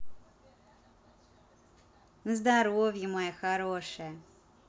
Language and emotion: Russian, positive